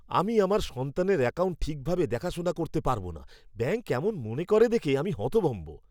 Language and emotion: Bengali, disgusted